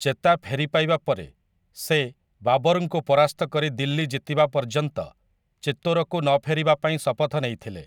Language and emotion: Odia, neutral